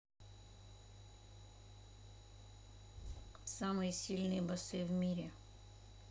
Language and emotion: Russian, neutral